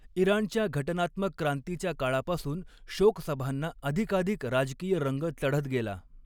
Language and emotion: Marathi, neutral